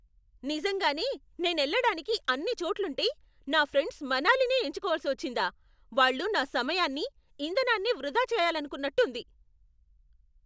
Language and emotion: Telugu, angry